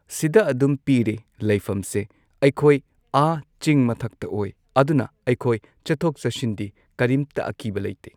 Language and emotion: Manipuri, neutral